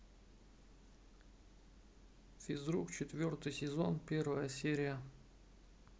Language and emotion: Russian, neutral